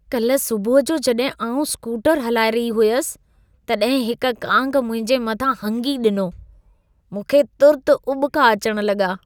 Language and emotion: Sindhi, disgusted